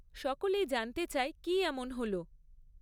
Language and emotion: Bengali, neutral